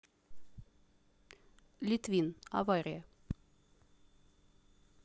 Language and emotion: Russian, neutral